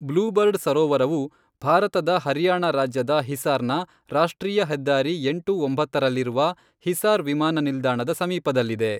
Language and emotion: Kannada, neutral